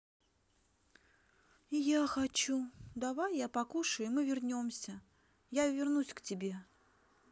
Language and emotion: Russian, sad